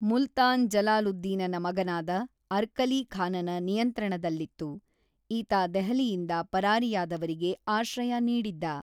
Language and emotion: Kannada, neutral